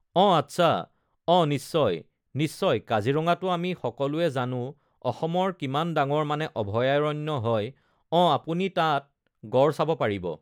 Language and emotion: Assamese, neutral